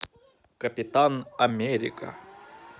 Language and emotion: Russian, positive